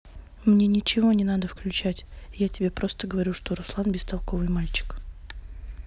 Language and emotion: Russian, neutral